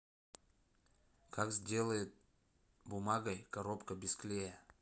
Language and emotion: Russian, neutral